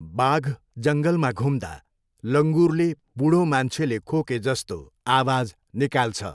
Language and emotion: Nepali, neutral